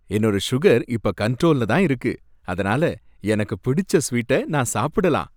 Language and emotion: Tamil, happy